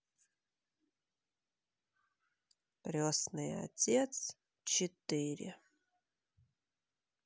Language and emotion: Russian, sad